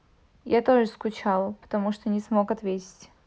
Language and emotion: Russian, neutral